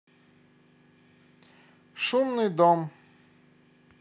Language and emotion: Russian, neutral